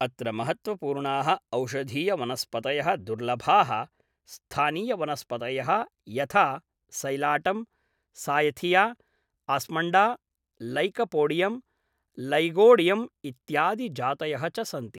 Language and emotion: Sanskrit, neutral